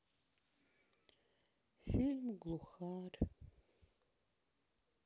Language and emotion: Russian, sad